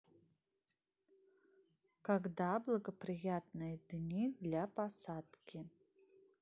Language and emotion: Russian, neutral